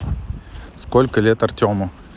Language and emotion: Russian, neutral